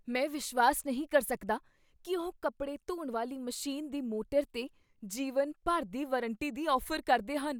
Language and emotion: Punjabi, surprised